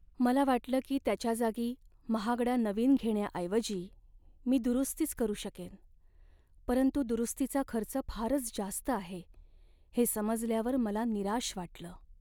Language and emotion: Marathi, sad